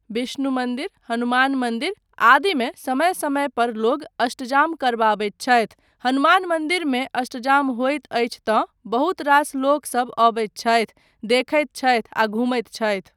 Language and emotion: Maithili, neutral